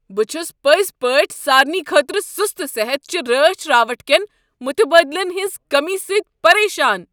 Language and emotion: Kashmiri, angry